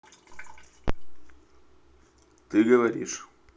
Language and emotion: Russian, neutral